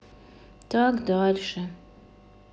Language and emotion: Russian, sad